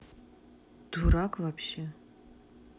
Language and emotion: Russian, neutral